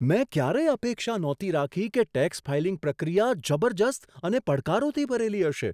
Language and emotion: Gujarati, surprised